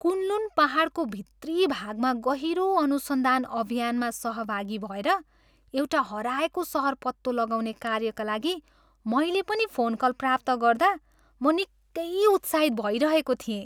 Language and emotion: Nepali, happy